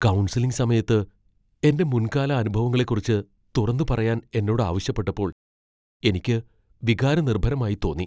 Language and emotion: Malayalam, fearful